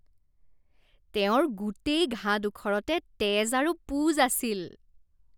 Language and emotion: Assamese, disgusted